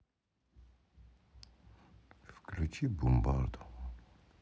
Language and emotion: Russian, sad